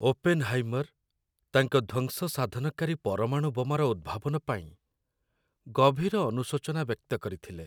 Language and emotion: Odia, sad